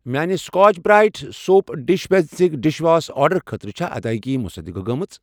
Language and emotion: Kashmiri, neutral